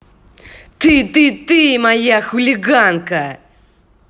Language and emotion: Russian, angry